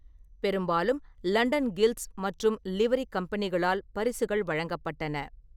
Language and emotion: Tamil, neutral